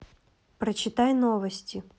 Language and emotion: Russian, neutral